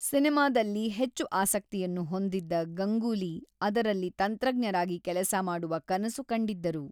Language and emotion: Kannada, neutral